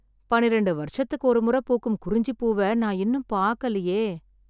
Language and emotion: Tamil, sad